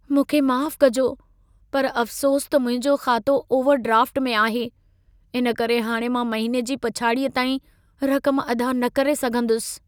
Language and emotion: Sindhi, sad